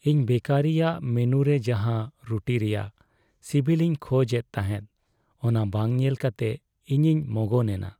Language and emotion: Santali, sad